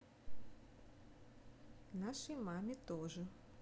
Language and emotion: Russian, neutral